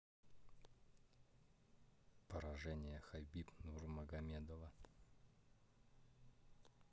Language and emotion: Russian, neutral